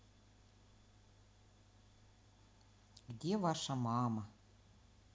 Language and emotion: Russian, neutral